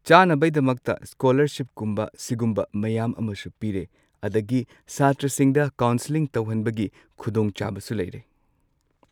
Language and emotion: Manipuri, neutral